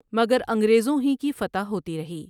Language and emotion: Urdu, neutral